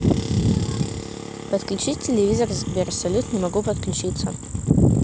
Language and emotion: Russian, neutral